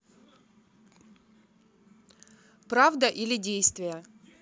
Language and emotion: Russian, neutral